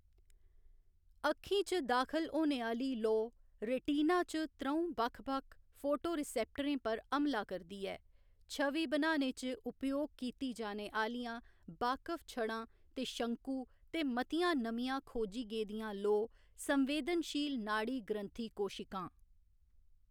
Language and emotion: Dogri, neutral